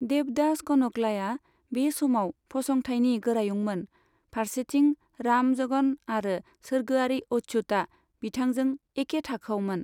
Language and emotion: Bodo, neutral